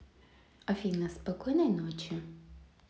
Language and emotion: Russian, neutral